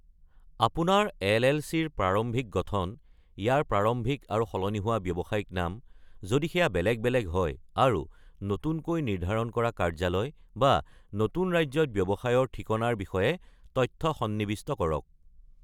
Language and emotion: Assamese, neutral